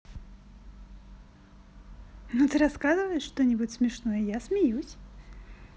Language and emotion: Russian, positive